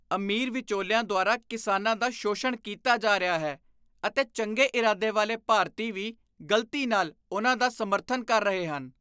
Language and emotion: Punjabi, disgusted